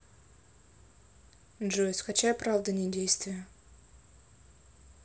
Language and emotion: Russian, neutral